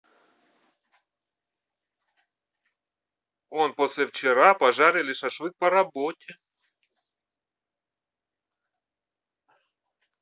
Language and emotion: Russian, neutral